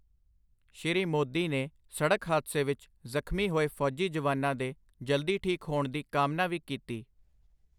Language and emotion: Punjabi, neutral